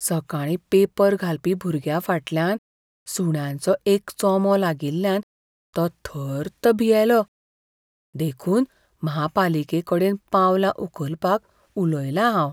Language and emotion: Goan Konkani, fearful